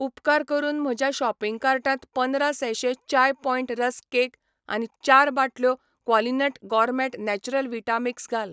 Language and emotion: Goan Konkani, neutral